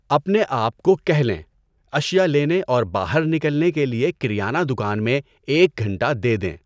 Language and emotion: Urdu, neutral